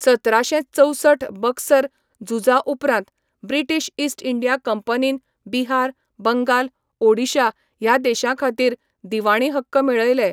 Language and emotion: Goan Konkani, neutral